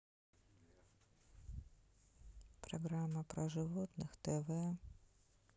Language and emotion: Russian, sad